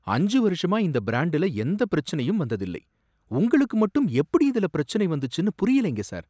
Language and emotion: Tamil, surprised